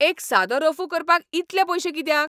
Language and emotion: Goan Konkani, angry